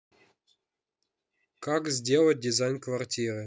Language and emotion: Russian, neutral